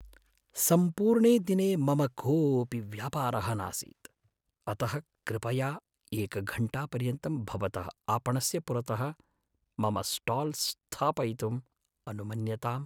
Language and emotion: Sanskrit, sad